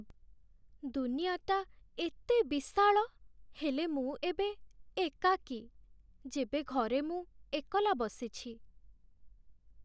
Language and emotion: Odia, sad